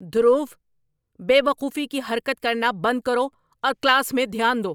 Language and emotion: Urdu, angry